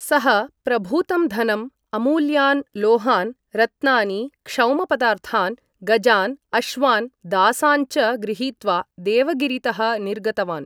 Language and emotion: Sanskrit, neutral